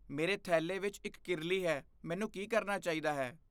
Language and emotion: Punjabi, fearful